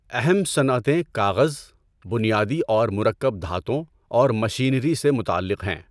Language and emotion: Urdu, neutral